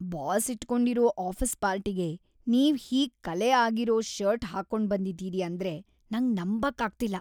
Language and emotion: Kannada, disgusted